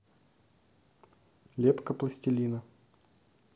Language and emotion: Russian, neutral